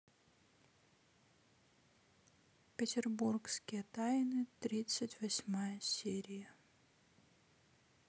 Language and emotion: Russian, sad